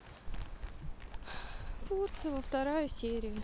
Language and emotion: Russian, sad